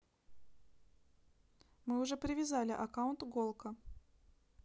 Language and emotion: Russian, neutral